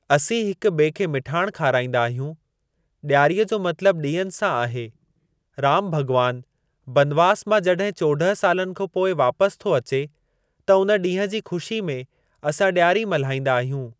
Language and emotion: Sindhi, neutral